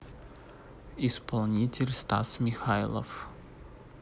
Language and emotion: Russian, neutral